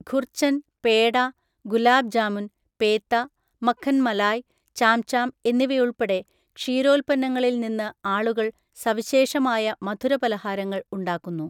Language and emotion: Malayalam, neutral